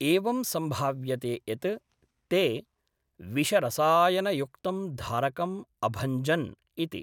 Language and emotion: Sanskrit, neutral